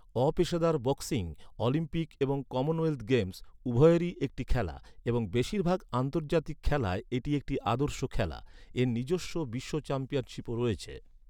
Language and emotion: Bengali, neutral